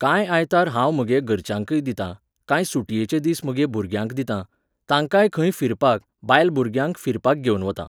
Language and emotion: Goan Konkani, neutral